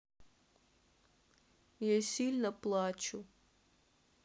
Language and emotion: Russian, sad